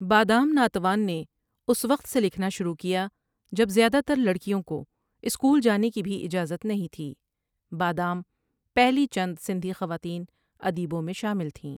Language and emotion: Urdu, neutral